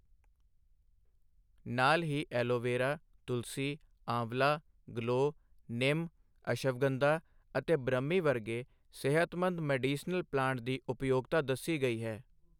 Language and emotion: Punjabi, neutral